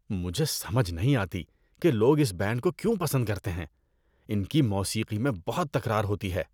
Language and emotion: Urdu, disgusted